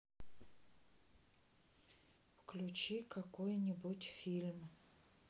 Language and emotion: Russian, sad